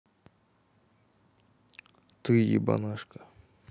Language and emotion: Russian, neutral